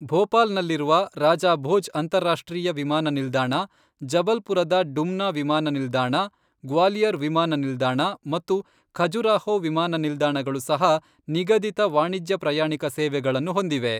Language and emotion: Kannada, neutral